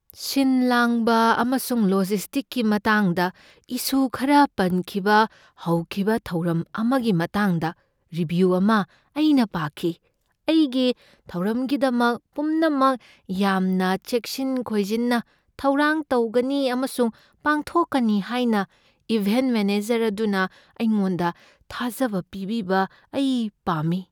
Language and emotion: Manipuri, fearful